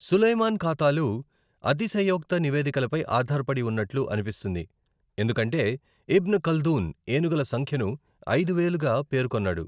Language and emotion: Telugu, neutral